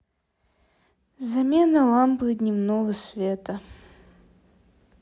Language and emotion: Russian, sad